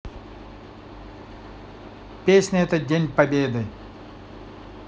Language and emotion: Russian, neutral